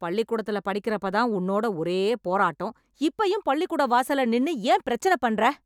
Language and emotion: Tamil, angry